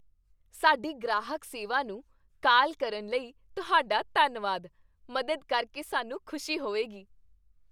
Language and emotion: Punjabi, happy